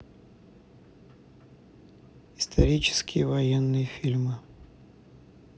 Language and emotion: Russian, neutral